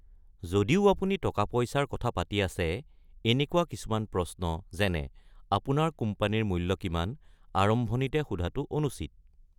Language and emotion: Assamese, neutral